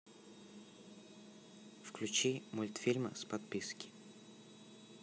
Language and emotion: Russian, neutral